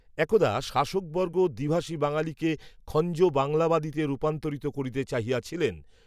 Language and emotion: Bengali, neutral